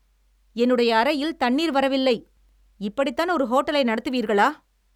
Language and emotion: Tamil, angry